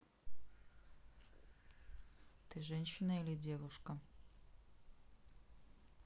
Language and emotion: Russian, neutral